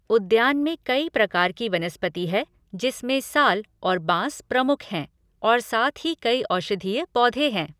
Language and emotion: Hindi, neutral